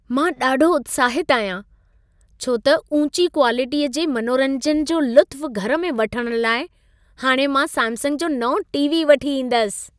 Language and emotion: Sindhi, happy